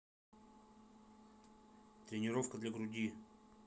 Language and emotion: Russian, neutral